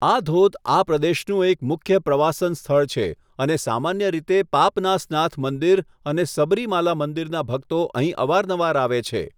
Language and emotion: Gujarati, neutral